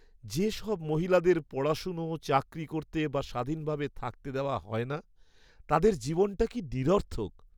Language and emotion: Bengali, sad